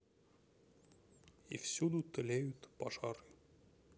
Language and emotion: Russian, sad